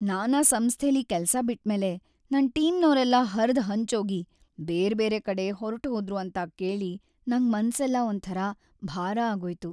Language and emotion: Kannada, sad